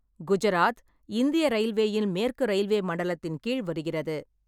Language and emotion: Tamil, neutral